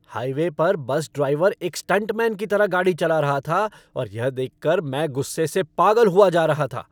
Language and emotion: Hindi, angry